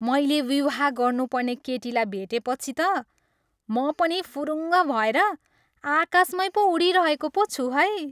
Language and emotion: Nepali, happy